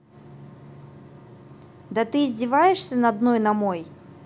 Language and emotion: Russian, angry